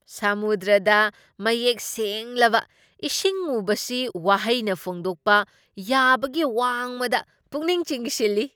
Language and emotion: Manipuri, surprised